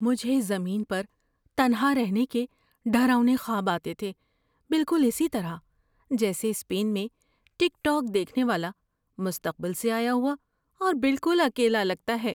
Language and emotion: Urdu, fearful